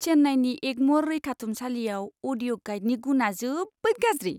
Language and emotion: Bodo, disgusted